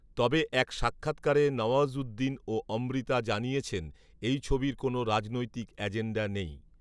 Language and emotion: Bengali, neutral